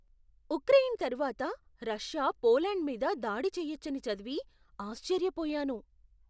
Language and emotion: Telugu, surprised